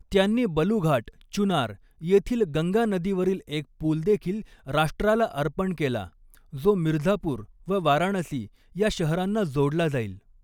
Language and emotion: Marathi, neutral